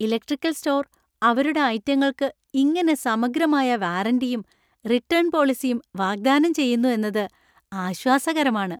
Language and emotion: Malayalam, happy